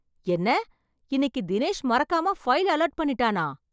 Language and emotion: Tamil, surprised